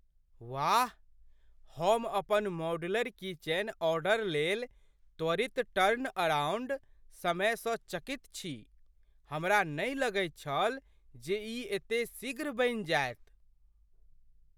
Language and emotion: Maithili, surprised